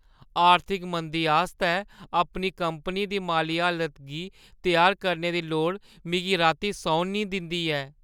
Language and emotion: Dogri, fearful